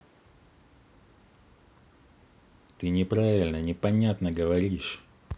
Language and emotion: Russian, angry